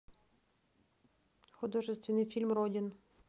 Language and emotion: Russian, neutral